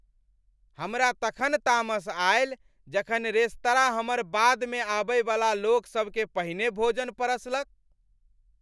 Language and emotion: Maithili, angry